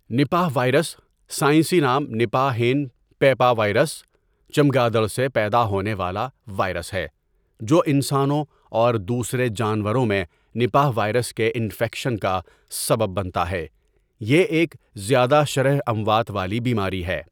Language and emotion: Urdu, neutral